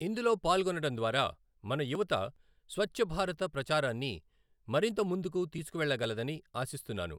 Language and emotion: Telugu, neutral